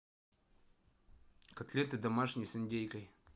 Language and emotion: Russian, neutral